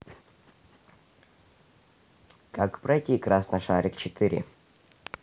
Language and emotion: Russian, neutral